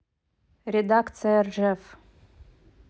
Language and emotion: Russian, neutral